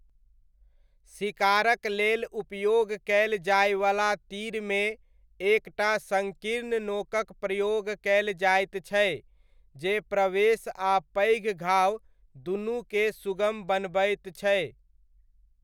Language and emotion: Maithili, neutral